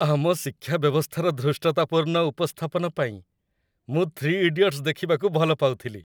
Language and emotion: Odia, happy